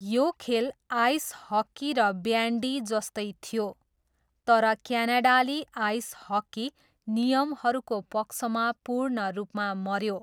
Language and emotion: Nepali, neutral